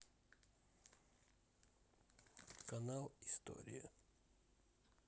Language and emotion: Russian, neutral